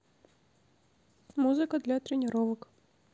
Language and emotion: Russian, neutral